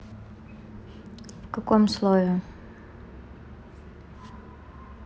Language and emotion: Russian, neutral